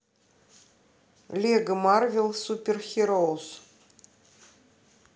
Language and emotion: Russian, neutral